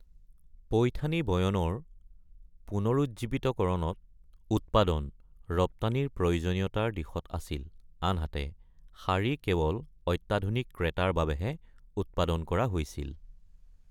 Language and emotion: Assamese, neutral